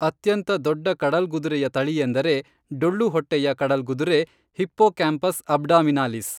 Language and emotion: Kannada, neutral